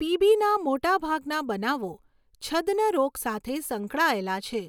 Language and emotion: Gujarati, neutral